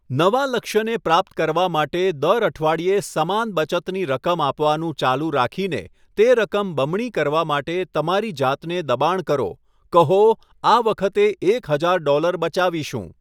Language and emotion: Gujarati, neutral